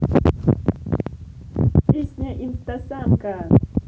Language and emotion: Russian, positive